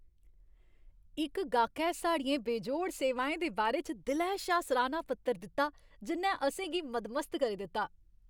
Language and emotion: Dogri, happy